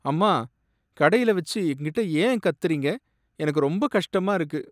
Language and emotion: Tamil, sad